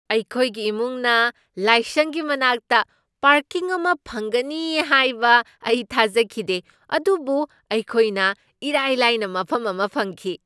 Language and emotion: Manipuri, surprised